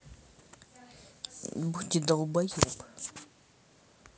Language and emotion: Russian, angry